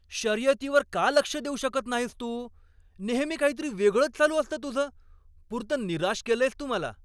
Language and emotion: Marathi, angry